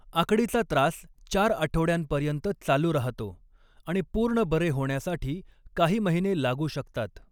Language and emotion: Marathi, neutral